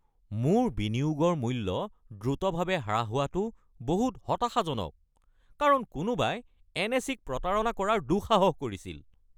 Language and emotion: Assamese, angry